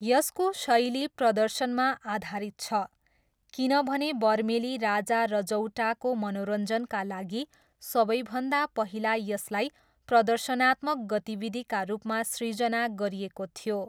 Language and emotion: Nepali, neutral